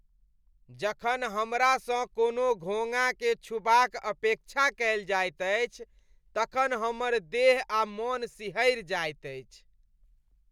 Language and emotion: Maithili, disgusted